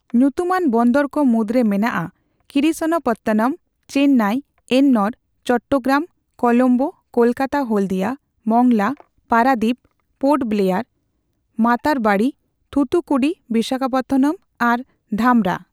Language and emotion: Santali, neutral